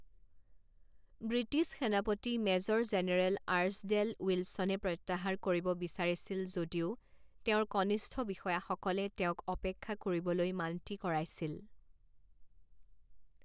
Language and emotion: Assamese, neutral